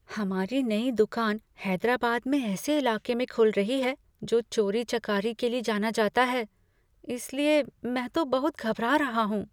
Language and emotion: Hindi, fearful